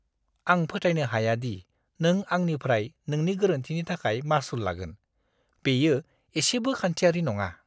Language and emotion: Bodo, disgusted